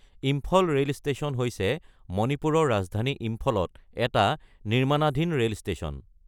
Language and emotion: Assamese, neutral